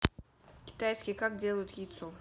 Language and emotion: Russian, neutral